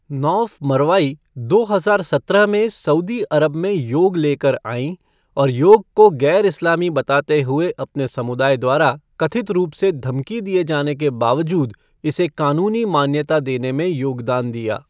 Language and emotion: Hindi, neutral